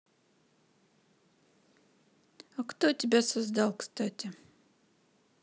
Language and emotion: Russian, neutral